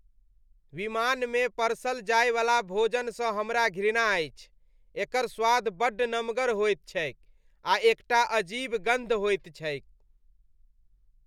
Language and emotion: Maithili, disgusted